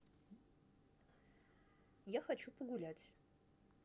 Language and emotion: Russian, neutral